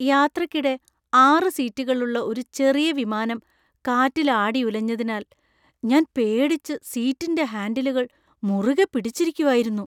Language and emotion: Malayalam, fearful